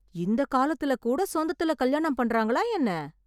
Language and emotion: Tamil, surprised